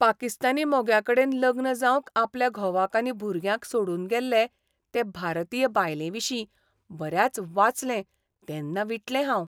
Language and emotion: Goan Konkani, disgusted